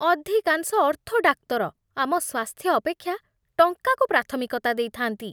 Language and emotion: Odia, disgusted